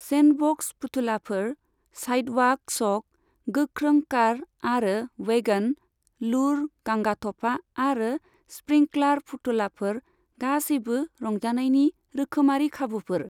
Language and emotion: Bodo, neutral